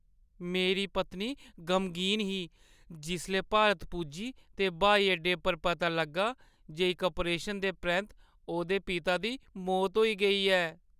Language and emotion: Dogri, sad